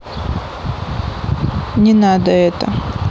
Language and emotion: Russian, neutral